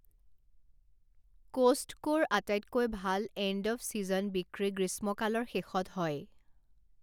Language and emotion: Assamese, neutral